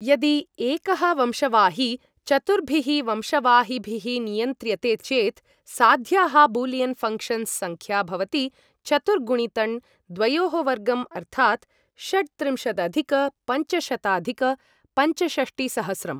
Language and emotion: Sanskrit, neutral